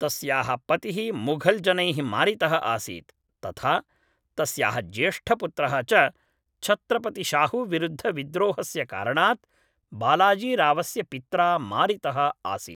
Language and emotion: Sanskrit, neutral